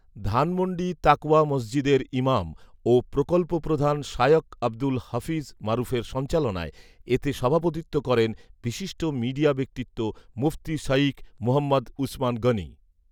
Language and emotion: Bengali, neutral